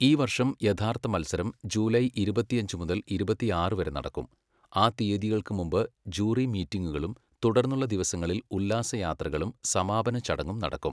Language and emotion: Malayalam, neutral